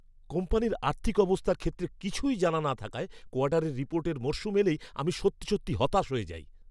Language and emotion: Bengali, angry